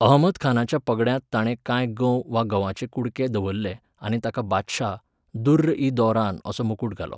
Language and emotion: Goan Konkani, neutral